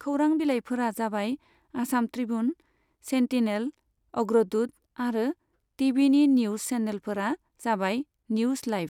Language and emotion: Bodo, neutral